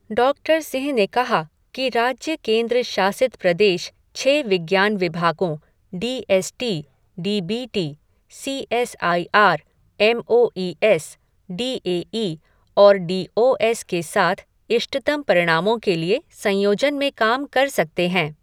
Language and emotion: Hindi, neutral